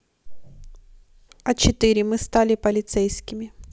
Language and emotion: Russian, neutral